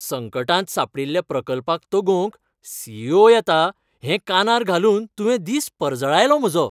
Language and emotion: Goan Konkani, happy